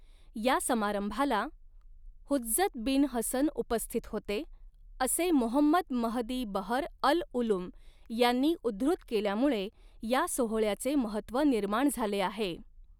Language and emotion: Marathi, neutral